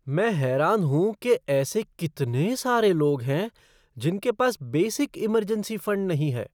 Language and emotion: Hindi, surprised